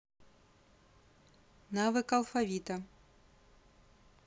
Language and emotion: Russian, neutral